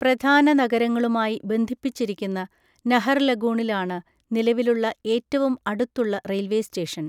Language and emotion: Malayalam, neutral